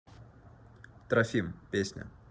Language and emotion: Russian, neutral